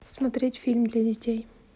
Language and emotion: Russian, neutral